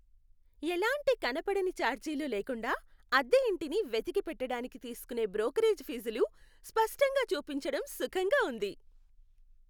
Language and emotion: Telugu, happy